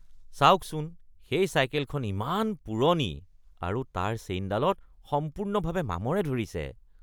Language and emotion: Assamese, disgusted